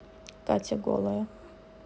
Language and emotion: Russian, neutral